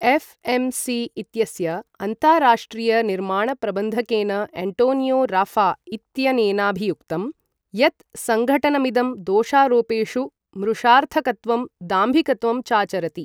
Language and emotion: Sanskrit, neutral